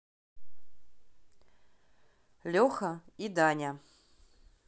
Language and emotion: Russian, neutral